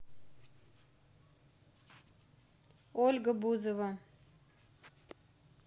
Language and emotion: Russian, neutral